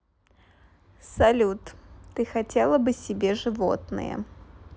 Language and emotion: Russian, positive